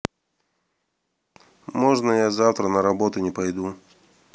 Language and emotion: Russian, neutral